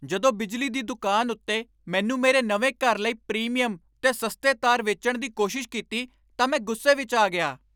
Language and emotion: Punjabi, angry